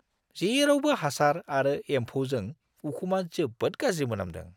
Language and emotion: Bodo, disgusted